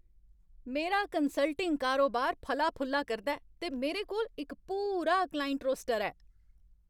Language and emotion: Dogri, happy